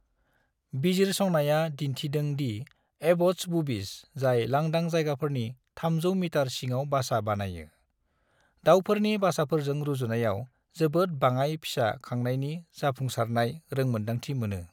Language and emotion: Bodo, neutral